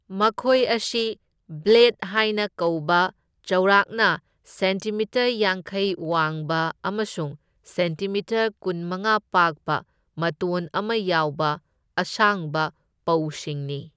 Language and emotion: Manipuri, neutral